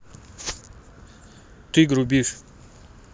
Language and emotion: Russian, neutral